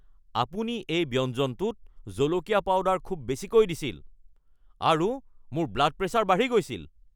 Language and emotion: Assamese, angry